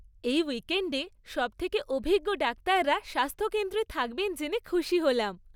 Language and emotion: Bengali, happy